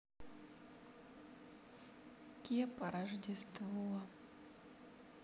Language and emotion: Russian, sad